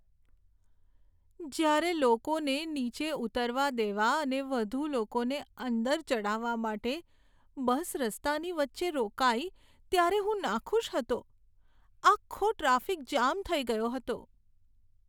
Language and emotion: Gujarati, sad